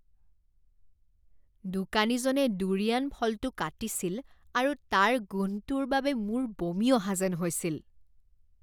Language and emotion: Assamese, disgusted